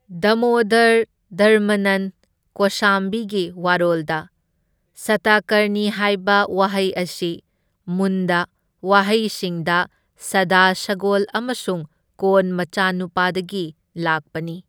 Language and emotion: Manipuri, neutral